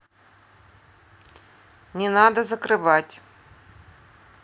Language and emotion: Russian, neutral